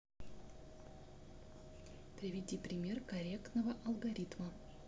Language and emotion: Russian, neutral